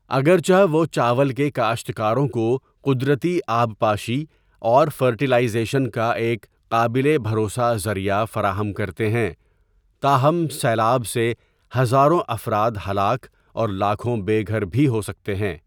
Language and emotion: Urdu, neutral